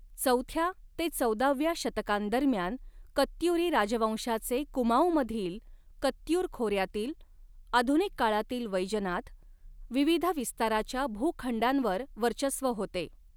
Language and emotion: Marathi, neutral